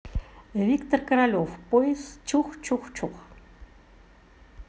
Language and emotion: Russian, positive